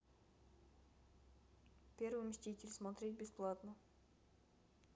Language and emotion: Russian, neutral